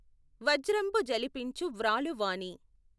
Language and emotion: Telugu, neutral